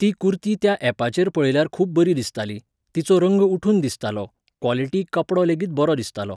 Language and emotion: Goan Konkani, neutral